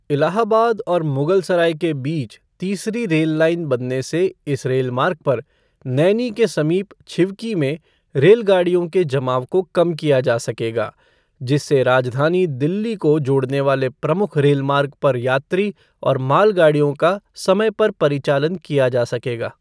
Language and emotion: Hindi, neutral